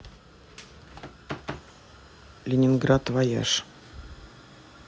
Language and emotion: Russian, neutral